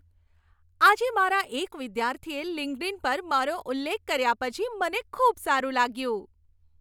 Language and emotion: Gujarati, happy